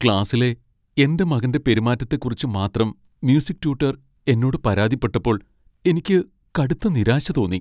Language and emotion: Malayalam, sad